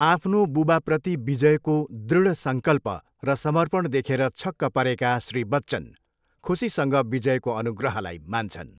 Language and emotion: Nepali, neutral